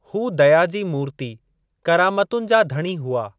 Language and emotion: Sindhi, neutral